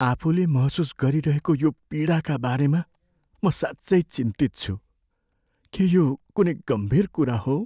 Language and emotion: Nepali, fearful